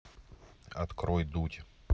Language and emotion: Russian, neutral